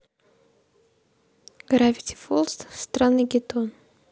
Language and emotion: Russian, neutral